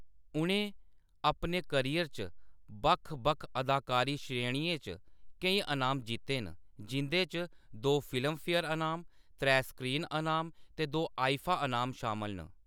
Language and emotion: Dogri, neutral